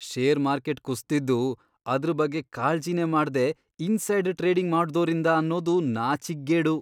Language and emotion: Kannada, disgusted